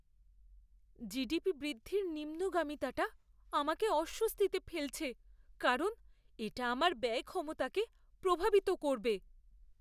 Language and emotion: Bengali, fearful